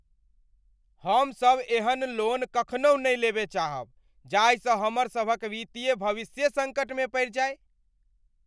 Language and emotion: Maithili, angry